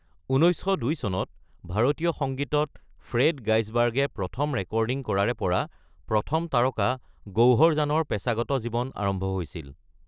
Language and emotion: Assamese, neutral